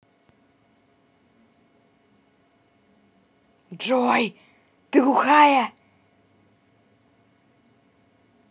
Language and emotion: Russian, angry